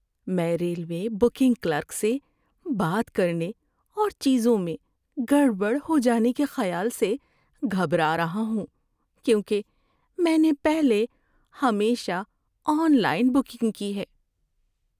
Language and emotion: Urdu, fearful